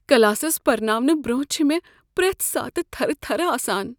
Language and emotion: Kashmiri, fearful